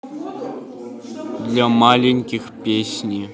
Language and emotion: Russian, neutral